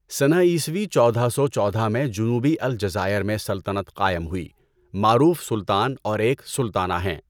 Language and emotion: Urdu, neutral